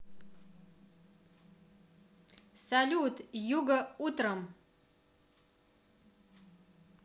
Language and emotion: Russian, positive